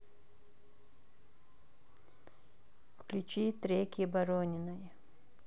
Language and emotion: Russian, neutral